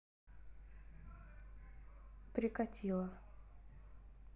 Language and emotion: Russian, neutral